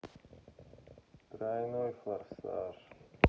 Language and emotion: Russian, sad